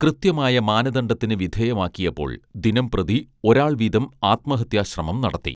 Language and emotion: Malayalam, neutral